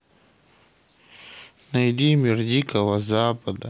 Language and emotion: Russian, sad